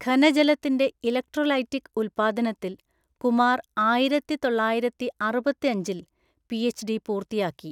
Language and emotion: Malayalam, neutral